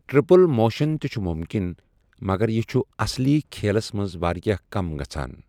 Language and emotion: Kashmiri, neutral